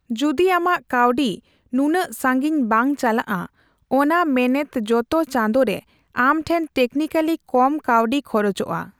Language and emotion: Santali, neutral